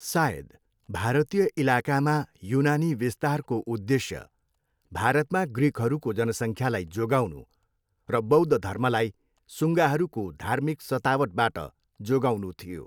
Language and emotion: Nepali, neutral